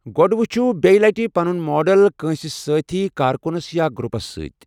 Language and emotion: Kashmiri, neutral